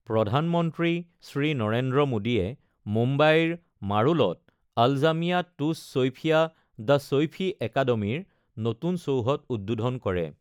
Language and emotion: Assamese, neutral